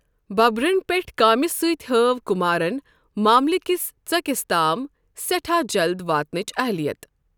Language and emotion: Kashmiri, neutral